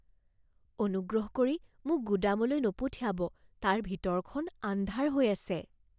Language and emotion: Assamese, fearful